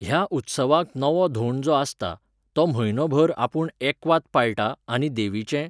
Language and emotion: Goan Konkani, neutral